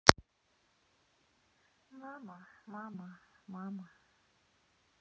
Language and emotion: Russian, sad